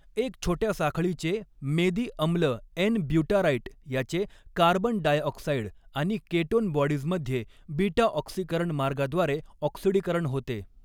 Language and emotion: Marathi, neutral